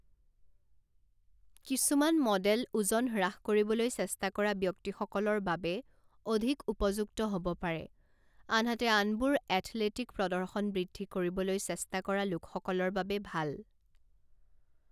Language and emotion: Assamese, neutral